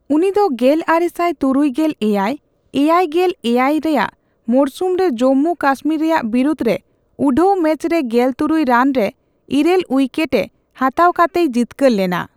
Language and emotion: Santali, neutral